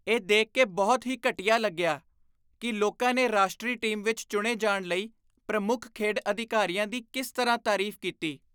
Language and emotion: Punjabi, disgusted